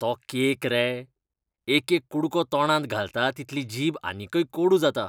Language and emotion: Goan Konkani, disgusted